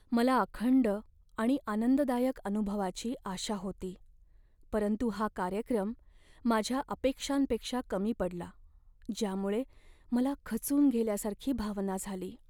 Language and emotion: Marathi, sad